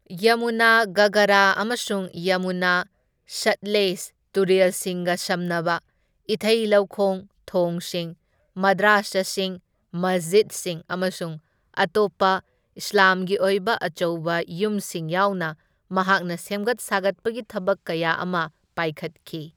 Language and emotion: Manipuri, neutral